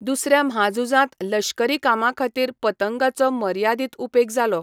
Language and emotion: Goan Konkani, neutral